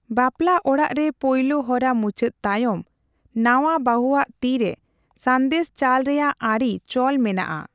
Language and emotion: Santali, neutral